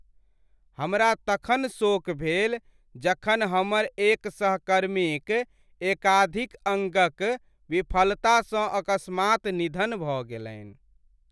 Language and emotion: Maithili, sad